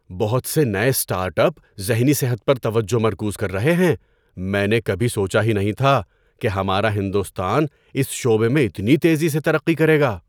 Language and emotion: Urdu, surprised